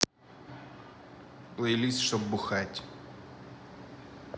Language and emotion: Russian, neutral